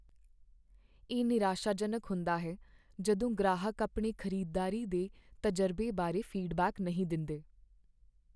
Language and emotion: Punjabi, sad